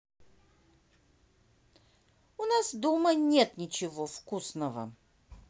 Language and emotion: Russian, neutral